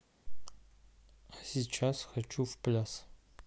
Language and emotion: Russian, neutral